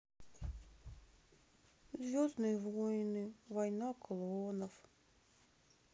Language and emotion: Russian, sad